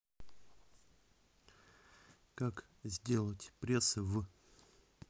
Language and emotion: Russian, neutral